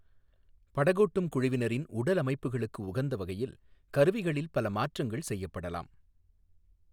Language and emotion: Tamil, neutral